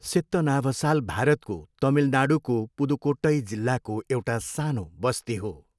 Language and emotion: Nepali, neutral